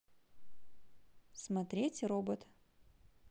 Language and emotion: Russian, neutral